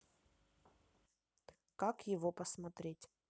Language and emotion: Russian, neutral